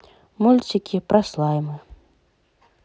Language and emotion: Russian, neutral